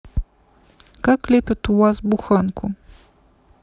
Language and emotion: Russian, neutral